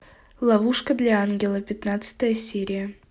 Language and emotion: Russian, neutral